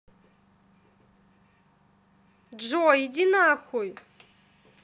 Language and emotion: Russian, angry